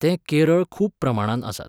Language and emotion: Goan Konkani, neutral